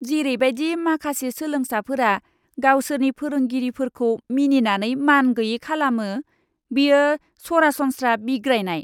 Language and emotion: Bodo, disgusted